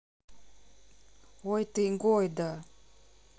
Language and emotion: Russian, neutral